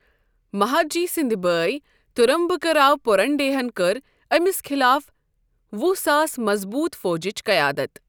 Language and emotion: Kashmiri, neutral